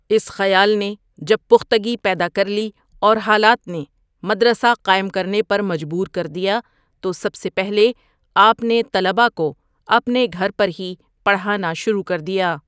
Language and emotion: Urdu, neutral